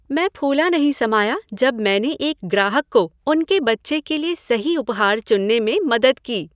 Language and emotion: Hindi, happy